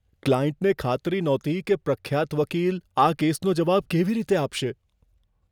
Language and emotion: Gujarati, fearful